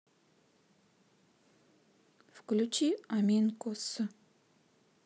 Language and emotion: Russian, neutral